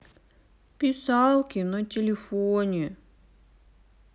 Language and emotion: Russian, sad